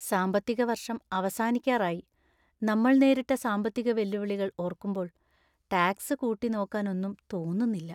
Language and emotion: Malayalam, sad